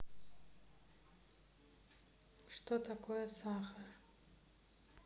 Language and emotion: Russian, neutral